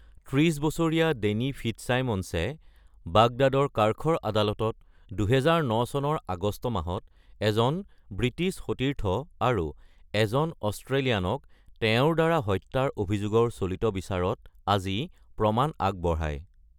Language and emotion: Assamese, neutral